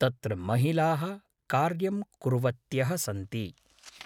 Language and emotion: Sanskrit, neutral